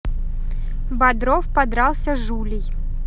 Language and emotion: Russian, neutral